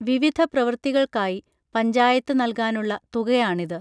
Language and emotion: Malayalam, neutral